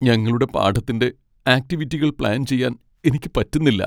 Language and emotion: Malayalam, sad